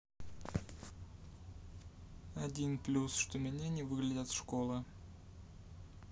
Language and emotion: Russian, neutral